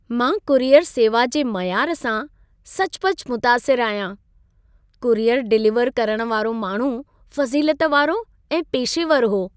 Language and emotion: Sindhi, happy